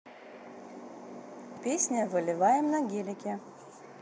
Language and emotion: Russian, neutral